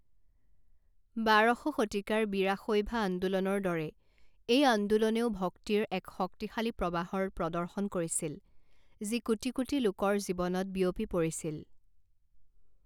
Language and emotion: Assamese, neutral